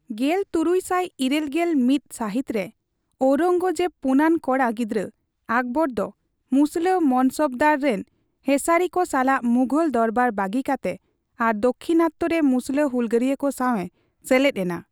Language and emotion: Santali, neutral